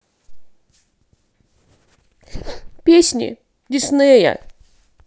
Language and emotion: Russian, sad